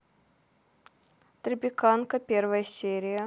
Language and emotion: Russian, neutral